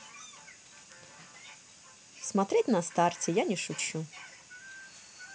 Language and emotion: Russian, neutral